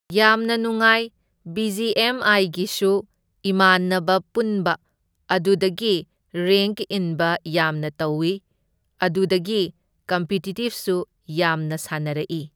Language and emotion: Manipuri, neutral